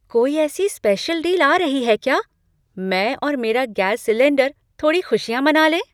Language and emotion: Hindi, surprised